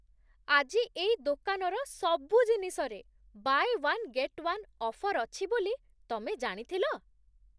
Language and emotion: Odia, surprised